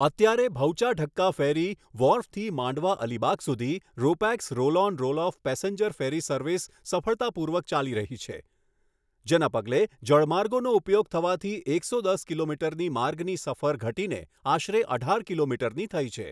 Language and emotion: Gujarati, neutral